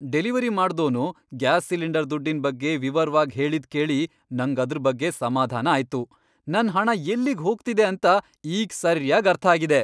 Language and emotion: Kannada, happy